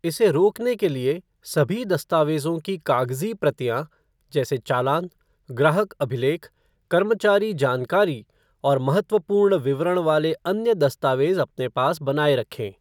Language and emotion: Hindi, neutral